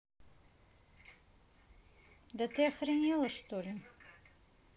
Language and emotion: Russian, neutral